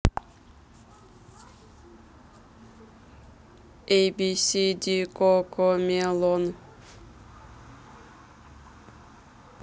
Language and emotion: Russian, neutral